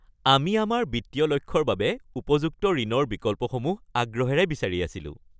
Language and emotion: Assamese, happy